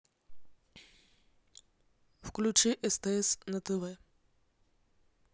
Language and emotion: Russian, neutral